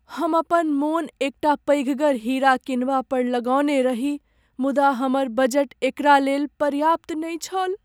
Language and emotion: Maithili, sad